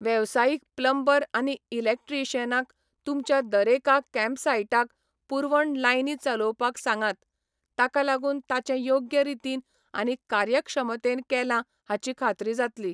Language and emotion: Goan Konkani, neutral